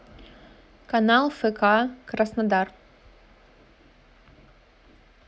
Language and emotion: Russian, neutral